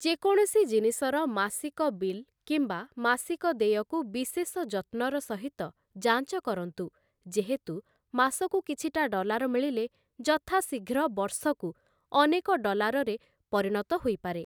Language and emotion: Odia, neutral